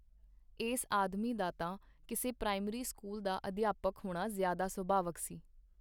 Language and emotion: Punjabi, neutral